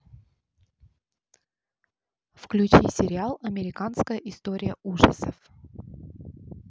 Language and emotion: Russian, neutral